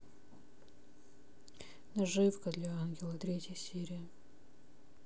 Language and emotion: Russian, neutral